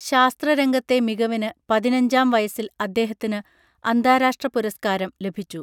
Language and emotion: Malayalam, neutral